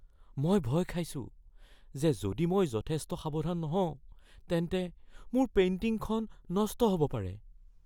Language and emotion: Assamese, fearful